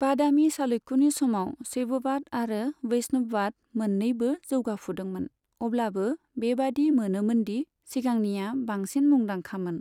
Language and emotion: Bodo, neutral